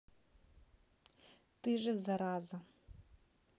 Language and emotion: Russian, neutral